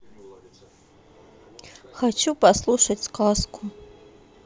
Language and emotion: Russian, sad